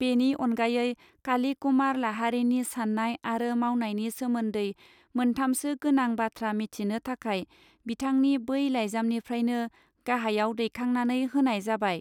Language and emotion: Bodo, neutral